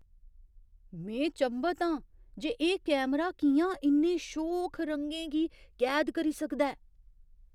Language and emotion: Dogri, surprised